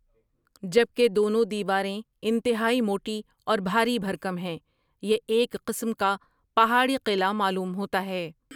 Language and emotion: Urdu, neutral